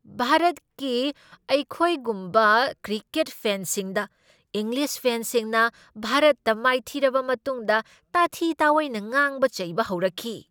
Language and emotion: Manipuri, angry